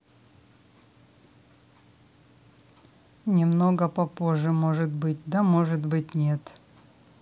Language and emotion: Russian, neutral